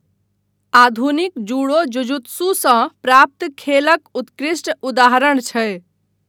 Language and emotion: Maithili, neutral